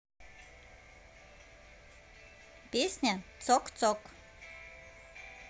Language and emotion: Russian, positive